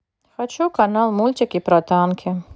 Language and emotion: Russian, neutral